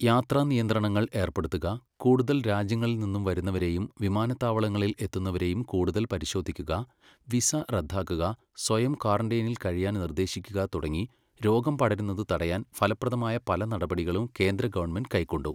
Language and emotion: Malayalam, neutral